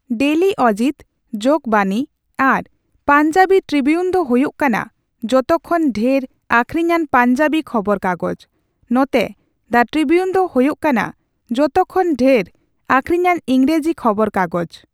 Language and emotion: Santali, neutral